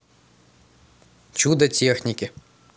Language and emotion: Russian, neutral